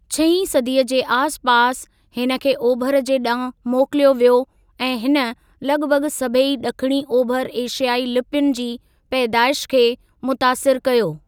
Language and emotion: Sindhi, neutral